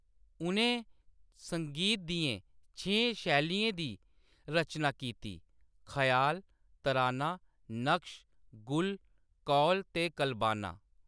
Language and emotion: Dogri, neutral